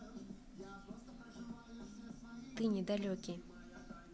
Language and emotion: Russian, neutral